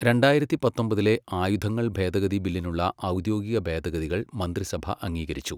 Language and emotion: Malayalam, neutral